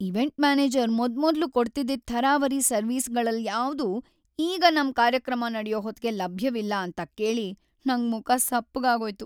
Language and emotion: Kannada, sad